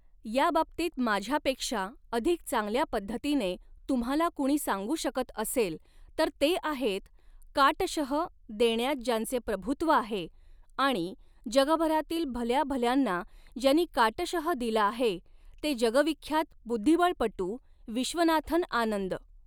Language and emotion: Marathi, neutral